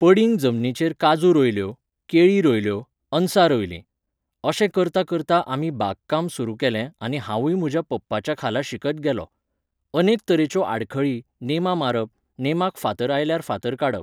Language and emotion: Goan Konkani, neutral